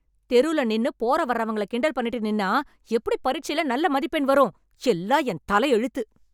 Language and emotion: Tamil, angry